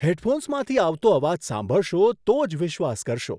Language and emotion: Gujarati, surprised